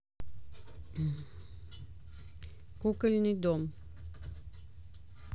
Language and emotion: Russian, neutral